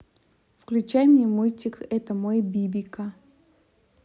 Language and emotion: Russian, neutral